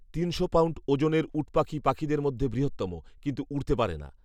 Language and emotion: Bengali, neutral